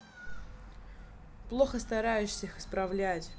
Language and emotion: Russian, angry